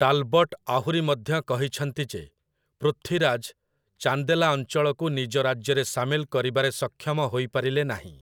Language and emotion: Odia, neutral